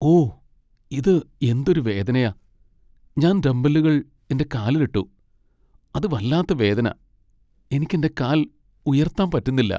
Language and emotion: Malayalam, sad